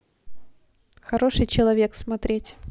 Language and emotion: Russian, neutral